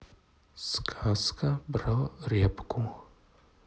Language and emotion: Russian, neutral